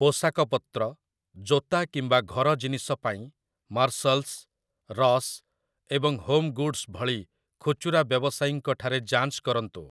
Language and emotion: Odia, neutral